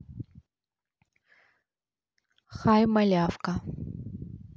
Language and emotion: Russian, neutral